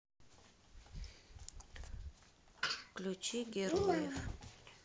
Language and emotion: Russian, neutral